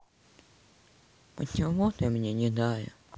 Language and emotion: Russian, sad